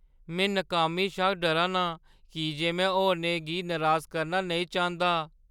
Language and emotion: Dogri, fearful